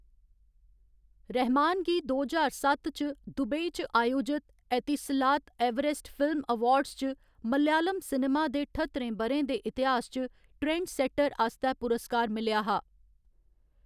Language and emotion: Dogri, neutral